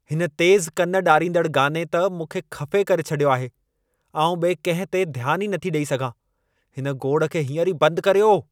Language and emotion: Sindhi, angry